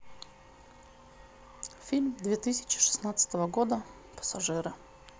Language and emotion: Russian, neutral